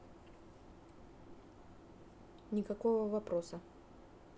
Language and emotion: Russian, neutral